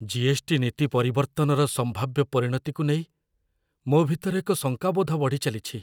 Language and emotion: Odia, fearful